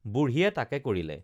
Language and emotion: Assamese, neutral